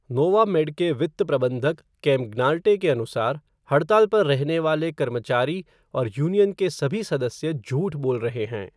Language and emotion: Hindi, neutral